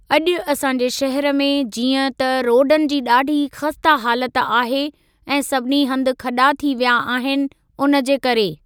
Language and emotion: Sindhi, neutral